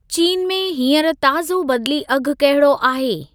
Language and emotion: Sindhi, neutral